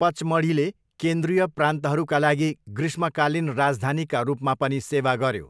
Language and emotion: Nepali, neutral